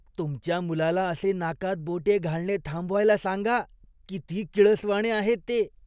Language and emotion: Marathi, disgusted